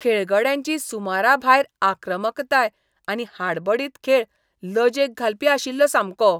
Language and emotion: Goan Konkani, disgusted